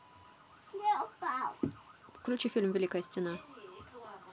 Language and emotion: Russian, neutral